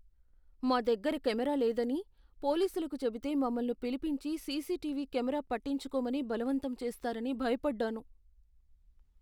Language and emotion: Telugu, fearful